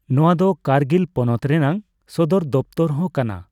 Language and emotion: Santali, neutral